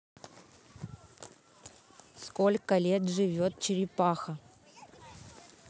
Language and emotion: Russian, neutral